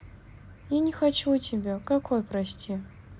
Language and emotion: Russian, sad